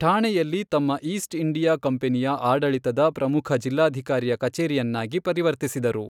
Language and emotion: Kannada, neutral